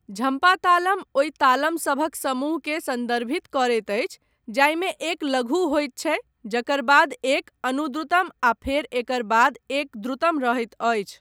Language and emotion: Maithili, neutral